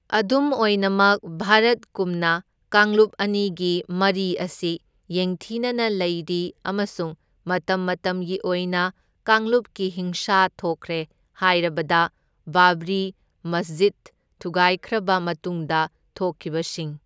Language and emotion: Manipuri, neutral